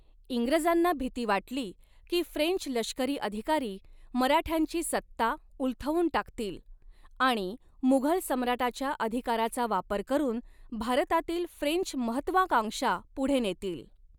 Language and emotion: Marathi, neutral